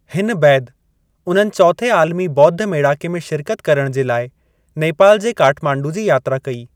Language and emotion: Sindhi, neutral